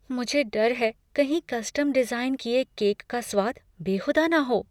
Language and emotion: Hindi, fearful